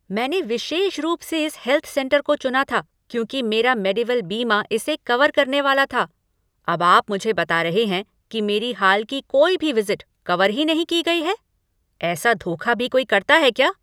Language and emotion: Hindi, angry